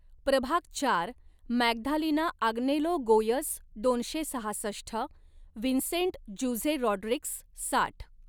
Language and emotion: Marathi, neutral